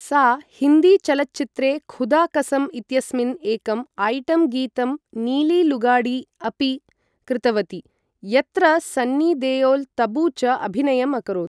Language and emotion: Sanskrit, neutral